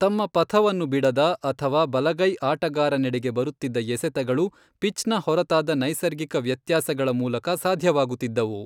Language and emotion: Kannada, neutral